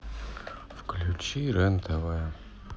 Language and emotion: Russian, sad